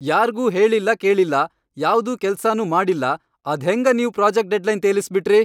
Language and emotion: Kannada, angry